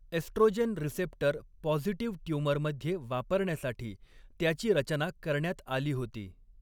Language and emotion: Marathi, neutral